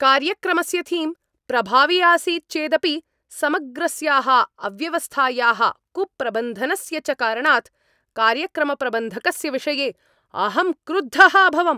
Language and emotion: Sanskrit, angry